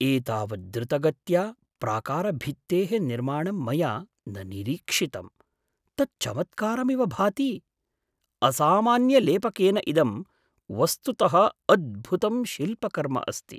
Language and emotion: Sanskrit, surprised